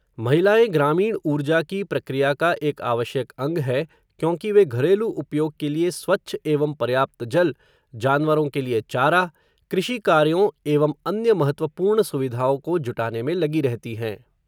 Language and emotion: Hindi, neutral